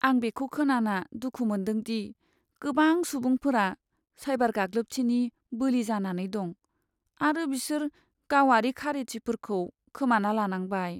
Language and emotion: Bodo, sad